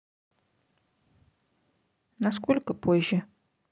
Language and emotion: Russian, neutral